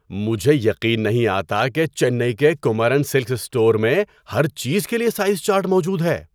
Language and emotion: Urdu, surprised